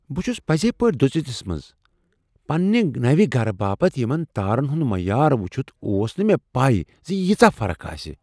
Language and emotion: Kashmiri, surprised